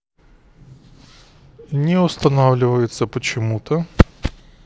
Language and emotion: Russian, neutral